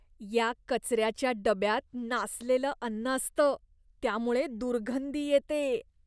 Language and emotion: Marathi, disgusted